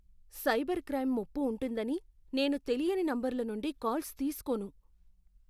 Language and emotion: Telugu, fearful